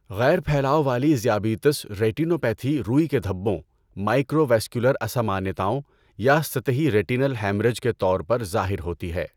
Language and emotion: Urdu, neutral